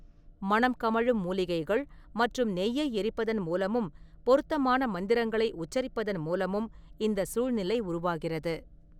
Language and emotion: Tamil, neutral